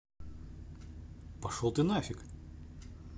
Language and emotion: Russian, neutral